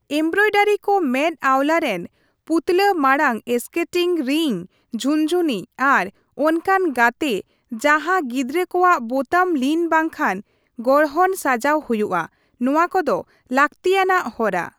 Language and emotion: Santali, neutral